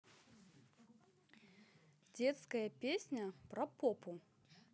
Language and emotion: Russian, positive